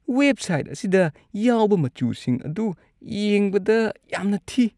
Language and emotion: Manipuri, disgusted